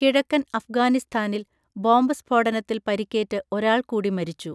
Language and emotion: Malayalam, neutral